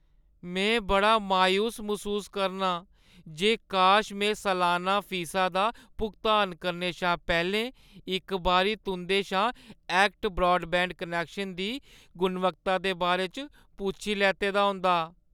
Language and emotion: Dogri, sad